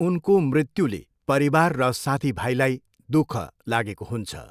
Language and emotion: Nepali, neutral